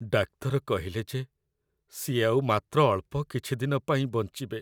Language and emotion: Odia, sad